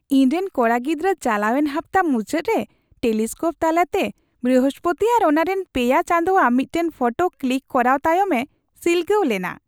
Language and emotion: Santali, happy